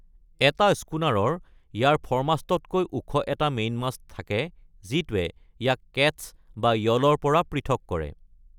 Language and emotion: Assamese, neutral